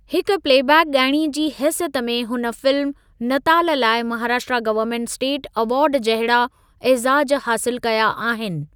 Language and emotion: Sindhi, neutral